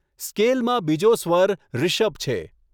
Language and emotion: Gujarati, neutral